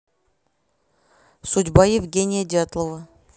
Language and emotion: Russian, neutral